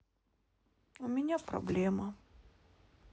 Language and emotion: Russian, sad